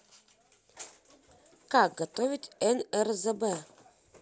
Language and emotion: Russian, neutral